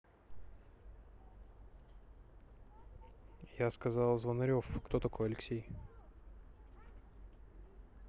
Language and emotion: Russian, neutral